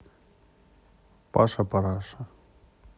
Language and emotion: Russian, neutral